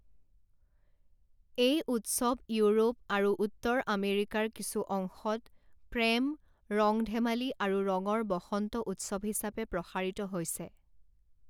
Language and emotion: Assamese, neutral